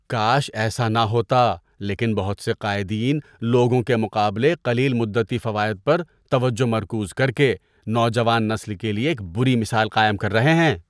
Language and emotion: Urdu, disgusted